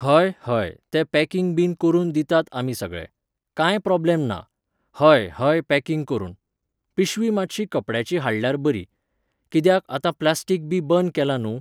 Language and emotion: Goan Konkani, neutral